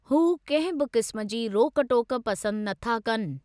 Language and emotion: Sindhi, neutral